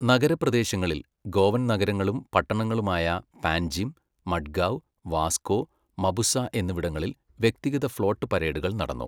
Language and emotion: Malayalam, neutral